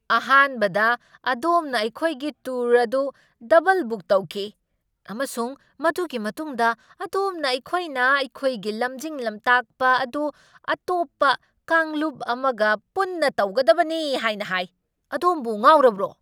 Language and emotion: Manipuri, angry